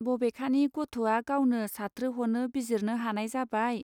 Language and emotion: Bodo, neutral